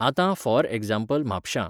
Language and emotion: Goan Konkani, neutral